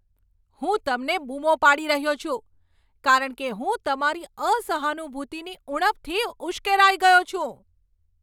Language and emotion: Gujarati, angry